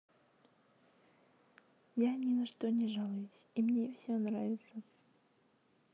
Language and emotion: Russian, neutral